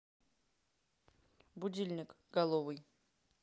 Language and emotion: Russian, neutral